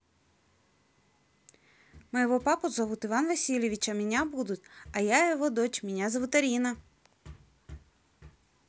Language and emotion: Russian, positive